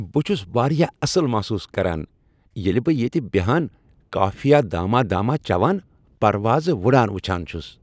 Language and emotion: Kashmiri, happy